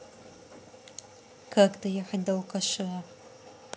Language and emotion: Russian, neutral